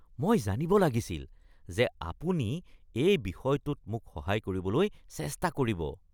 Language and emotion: Assamese, disgusted